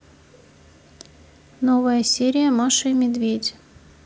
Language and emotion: Russian, neutral